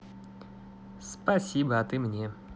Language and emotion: Russian, positive